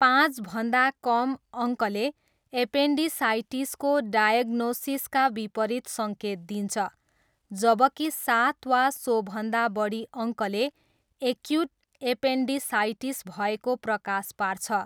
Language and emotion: Nepali, neutral